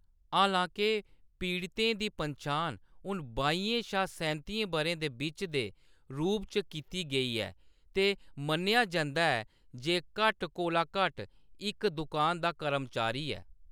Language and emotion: Dogri, neutral